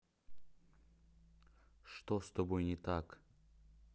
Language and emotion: Russian, neutral